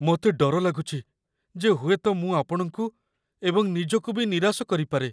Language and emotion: Odia, fearful